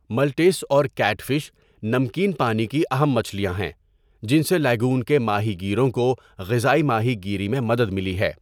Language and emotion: Urdu, neutral